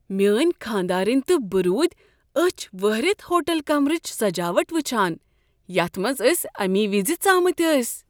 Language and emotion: Kashmiri, surprised